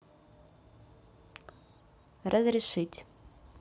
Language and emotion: Russian, neutral